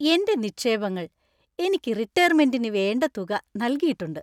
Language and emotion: Malayalam, happy